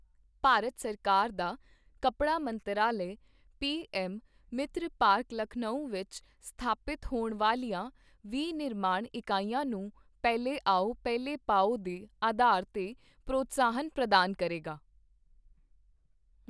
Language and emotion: Punjabi, neutral